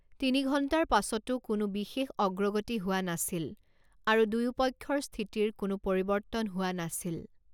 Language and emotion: Assamese, neutral